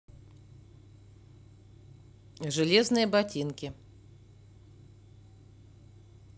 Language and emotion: Russian, neutral